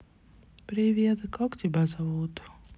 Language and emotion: Russian, sad